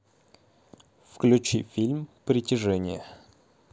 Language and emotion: Russian, neutral